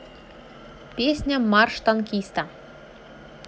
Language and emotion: Russian, positive